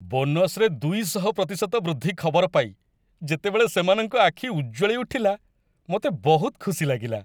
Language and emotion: Odia, happy